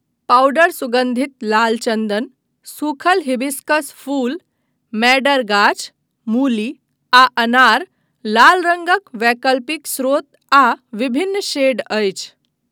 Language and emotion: Maithili, neutral